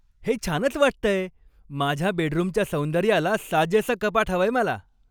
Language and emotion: Marathi, happy